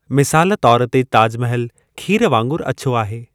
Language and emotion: Sindhi, neutral